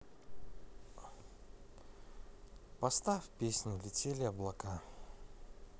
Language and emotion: Russian, neutral